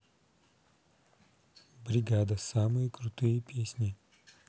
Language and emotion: Russian, neutral